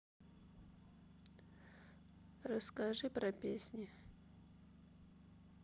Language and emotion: Russian, sad